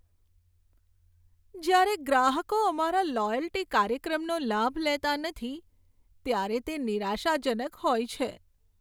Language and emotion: Gujarati, sad